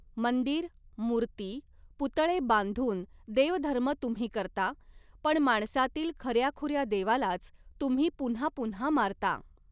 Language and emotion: Marathi, neutral